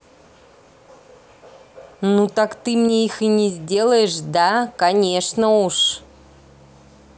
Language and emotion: Russian, angry